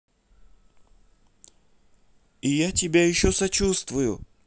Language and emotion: Russian, neutral